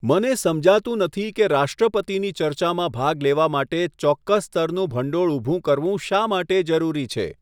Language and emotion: Gujarati, neutral